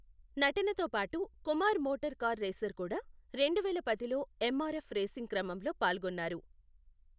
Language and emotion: Telugu, neutral